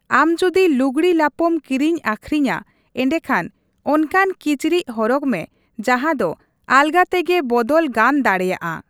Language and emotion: Santali, neutral